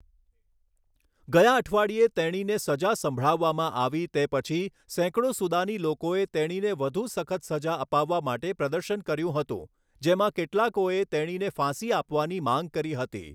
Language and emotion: Gujarati, neutral